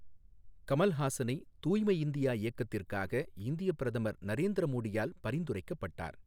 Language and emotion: Tamil, neutral